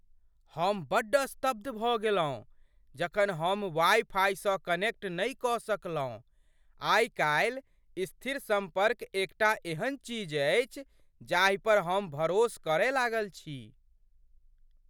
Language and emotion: Maithili, surprised